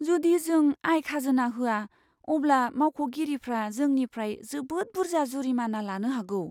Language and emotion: Bodo, fearful